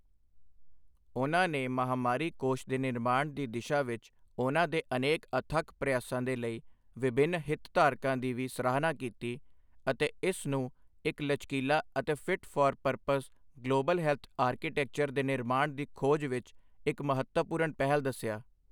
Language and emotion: Punjabi, neutral